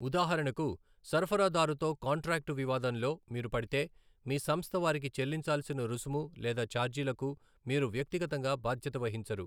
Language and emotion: Telugu, neutral